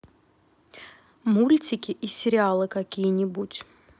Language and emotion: Russian, neutral